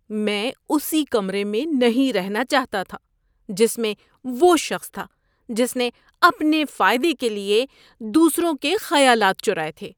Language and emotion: Urdu, disgusted